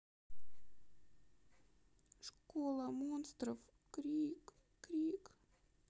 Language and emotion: Russian, sad